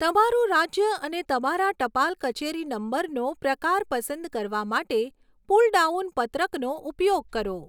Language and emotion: Gujarati, neutral